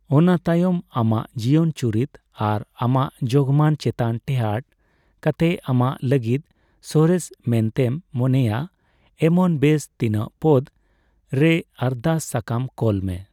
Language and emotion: Santali, neutral